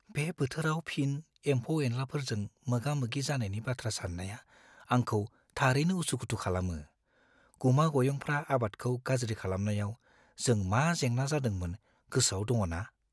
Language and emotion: Bodo, fearful